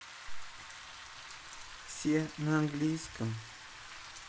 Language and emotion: Russian, sad